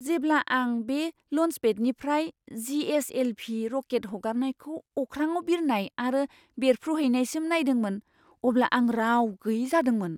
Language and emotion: Bodo, surprised